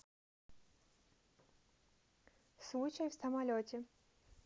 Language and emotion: Russian, neutral